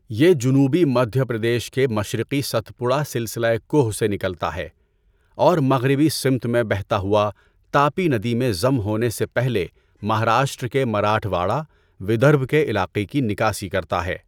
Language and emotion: Urdu, neutral